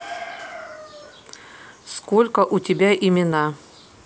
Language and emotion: Russian, neutral